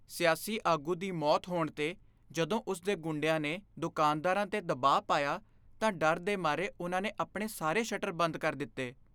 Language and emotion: Punjabi, fearful